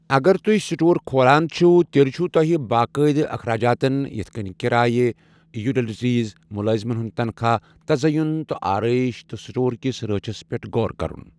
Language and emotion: Kashmiri, neutral